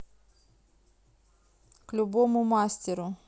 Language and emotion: Russian, neutral